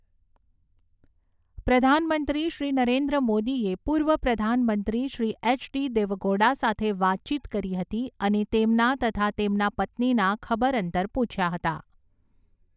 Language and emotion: Gujarati, neutral